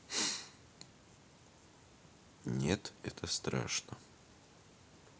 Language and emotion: Russian, neutral